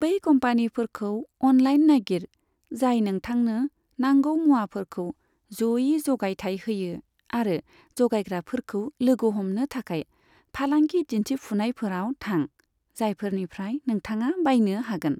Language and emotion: Bodo, neutral